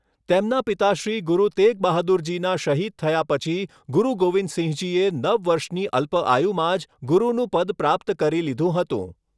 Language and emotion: Gujarati, neutral